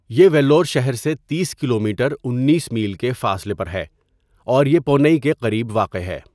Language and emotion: Urdu, neutral